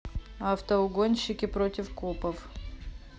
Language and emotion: Russian, neutral